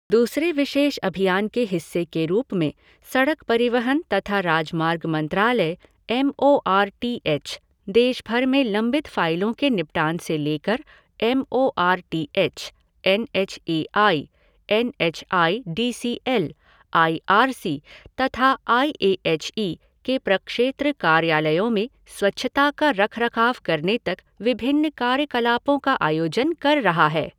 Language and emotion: Hindi, neutral